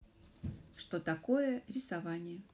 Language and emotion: Russian, neutral